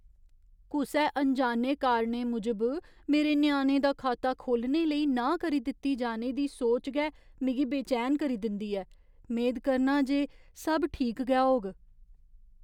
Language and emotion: Dogri, fearful